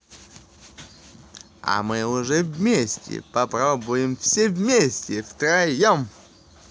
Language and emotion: Russian, positive